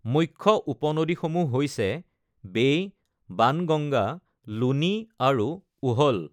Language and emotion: Assamese, neutral